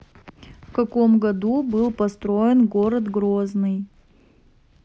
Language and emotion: Russian, neutral